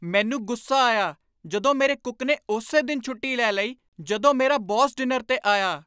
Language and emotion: Punjabi, angry